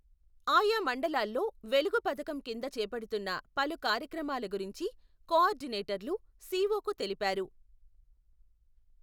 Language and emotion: Telugu, neutral